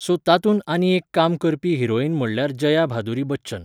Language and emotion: Goan Konkani, neutral